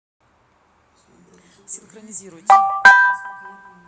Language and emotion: Russian, neutral